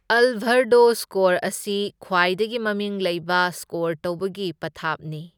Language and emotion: Manipuri, neutral